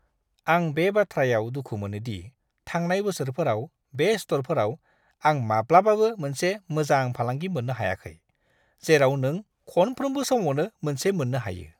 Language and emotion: Bodo, disgusted